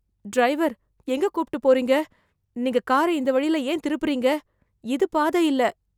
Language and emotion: Tamil, fearful